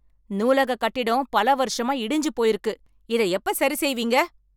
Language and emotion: Tamil, angry